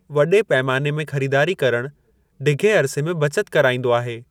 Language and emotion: Sindhi, neutral